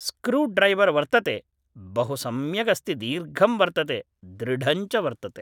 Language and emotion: Sanskrit, neutral